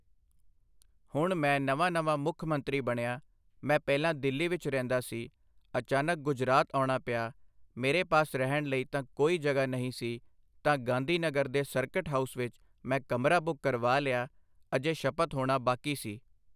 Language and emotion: Punjabi, neutral